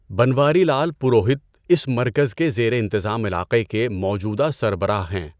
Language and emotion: Urdu, neutral